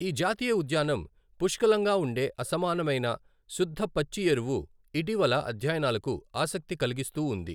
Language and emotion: Telugu, neutral